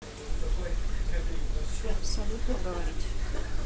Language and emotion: Russian, neutral